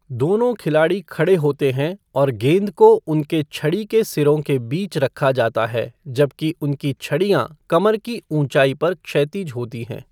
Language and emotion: Hindi, neutral